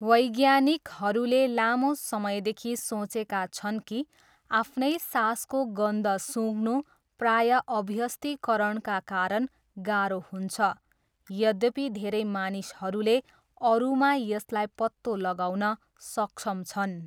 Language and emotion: Nepali, neutral